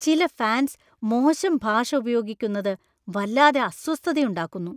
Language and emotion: Malayalam, disgusted